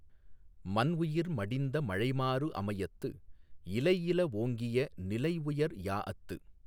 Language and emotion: Tamil, neutral